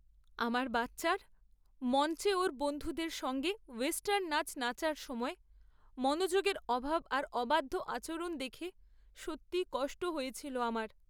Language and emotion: Bengali, sad